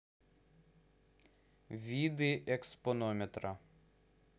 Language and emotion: Russian, neutral